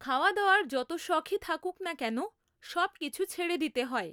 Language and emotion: Bengali, neutral